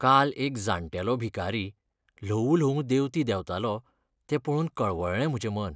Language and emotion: Goan Konkani, sad